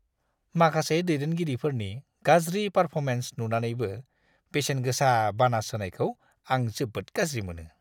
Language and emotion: Bodo, disgusted